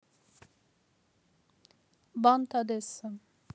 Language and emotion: Russian, neutral